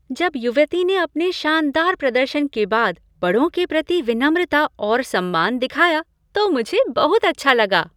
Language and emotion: Hindi, happy